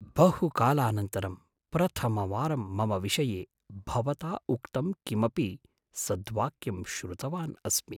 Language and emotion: Sanskrit, surprised